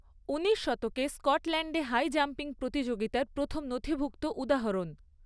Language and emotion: Bengali, neutral